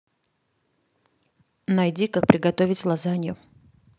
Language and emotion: Russian, neutral